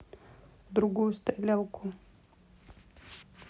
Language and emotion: Russian, neutral